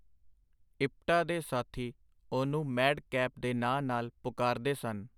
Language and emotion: Punjabi, neutral